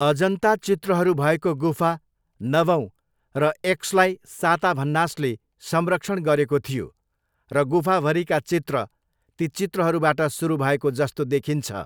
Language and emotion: Nepali, neutral